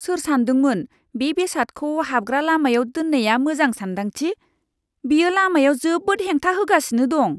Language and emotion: Bodo, disgusted